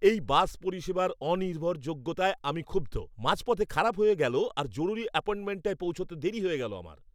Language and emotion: Bengali, angry